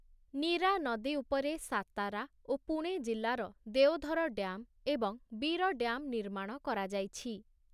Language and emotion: Odia, neutral